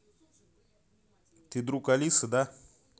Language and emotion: Russian, neutral